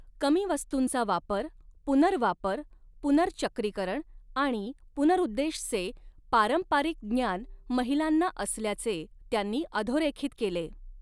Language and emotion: Marathi, neutral